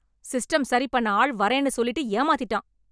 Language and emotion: Tamil, angry